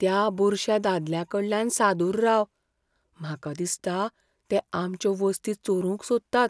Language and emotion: Goan Konkani, fearful